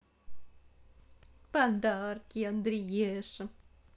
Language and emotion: Russian, positive